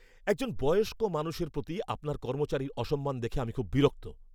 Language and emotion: Bengali, angry